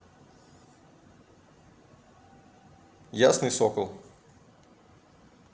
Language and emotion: Russian, neutral